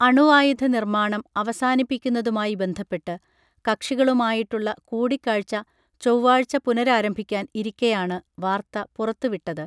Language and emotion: Malayalam, neutral